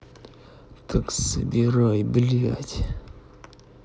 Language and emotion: Russian, angry